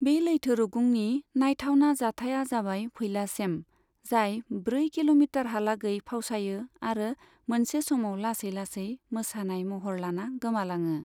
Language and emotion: Bodo, neutral